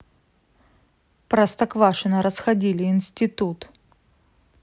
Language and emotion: Russian, neutral